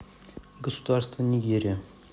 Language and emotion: Russian, neutral